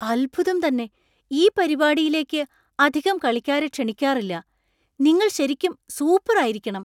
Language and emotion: Malayalam, surprised